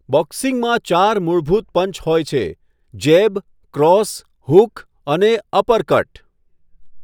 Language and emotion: Gujarati, neutral